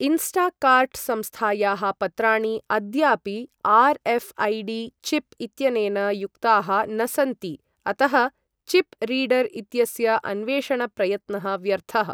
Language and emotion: Sanskrit, neutral